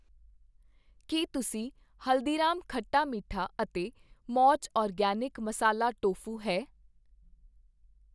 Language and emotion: Punjabi, neutral